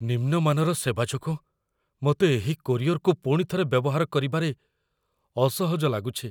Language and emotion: Odia, fearful